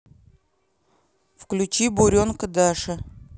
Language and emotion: Russian, neutral